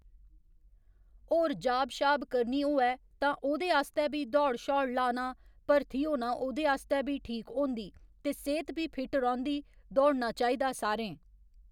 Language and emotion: Dogri, neutral